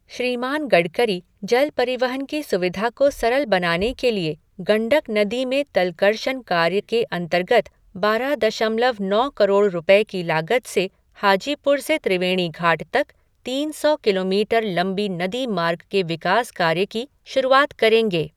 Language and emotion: Hindi, neutral